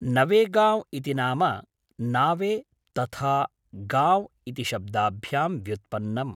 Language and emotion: Sanskrit, neutral